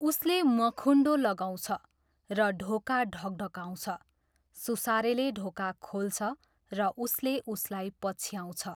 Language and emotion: Nepali, neutral